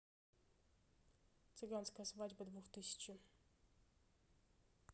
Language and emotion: Russian, neutral